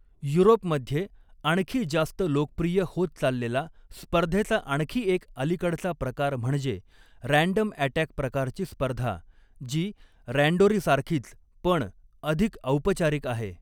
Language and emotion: Marathi, neutral